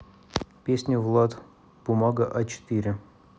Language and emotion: Russian, neutral